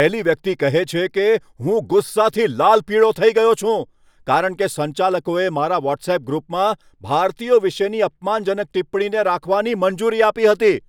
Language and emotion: Gujarati, angry